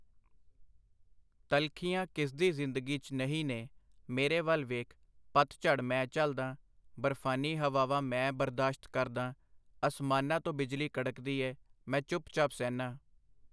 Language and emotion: Punjabi, neutral